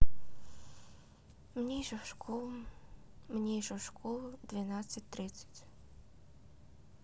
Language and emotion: Russian, sad